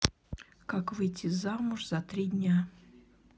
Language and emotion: Russian, neutral